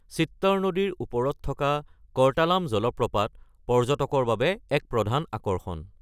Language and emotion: Assamese, neutral